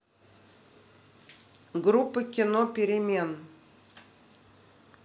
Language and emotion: Russian, neutral